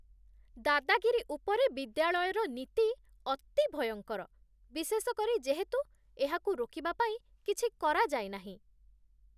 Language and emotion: Odia, disgusted